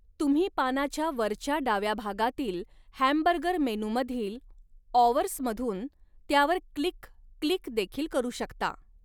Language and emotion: Marathi, neutral